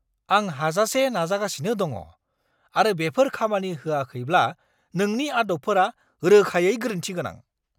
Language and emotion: Bodo, angry